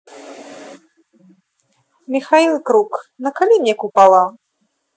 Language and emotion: Russian, neutral